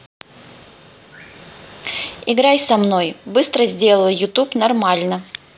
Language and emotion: Russian, neutral